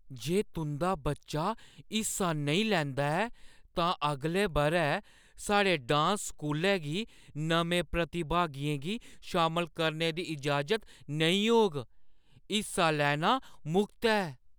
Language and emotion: Dogri, fearful